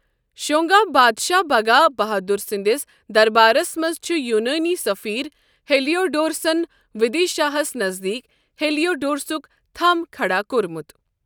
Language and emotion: Kashmiri, neutral